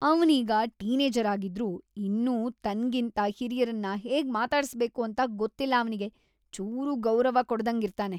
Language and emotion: Kannada, disgusted